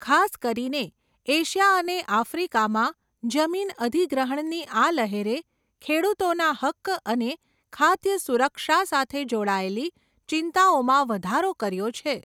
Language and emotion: Gujarati, neutral